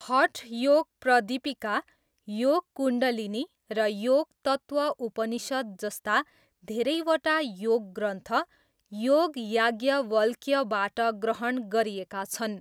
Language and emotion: Nepali, neutral